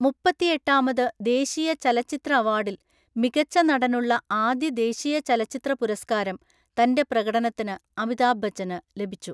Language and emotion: Malayalam, neutral